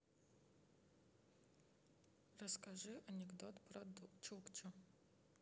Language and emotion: Russian, neutral